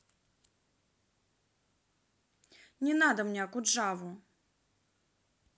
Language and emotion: Russian, angry